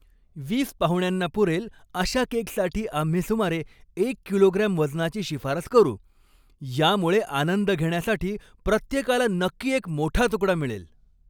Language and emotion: Marathi, happy